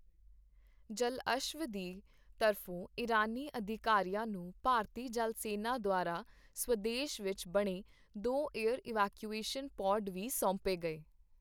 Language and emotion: Punjabi, neutral